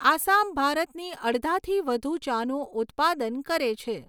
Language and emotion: Gujarati, neutral